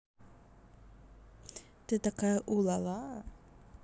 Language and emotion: Russian, positive